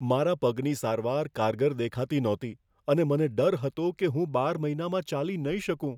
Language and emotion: Gujarati, fearful